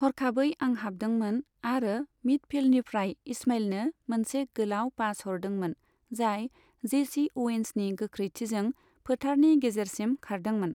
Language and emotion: Bodo, neutral